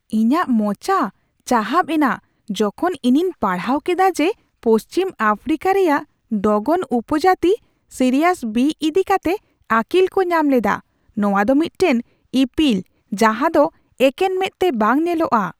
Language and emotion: Santali, surprised